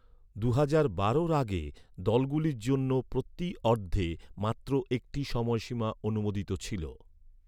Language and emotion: Bengali, neutral